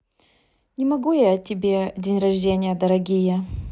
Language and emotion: Russian, neutral